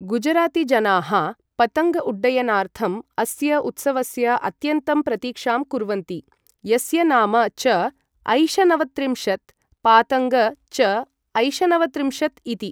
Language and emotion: Sanskrit, neutral